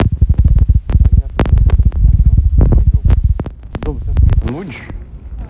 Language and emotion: Russian, neutral